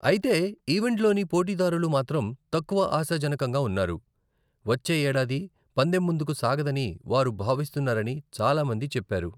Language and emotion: Telugu, neutral